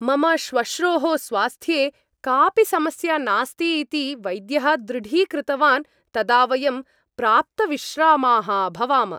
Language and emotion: Sanskrit, happy